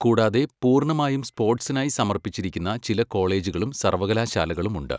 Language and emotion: Malayalam, neutral